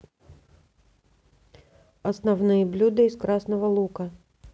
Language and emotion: Russian, neutral